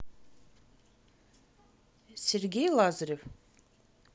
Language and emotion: Russian, neutral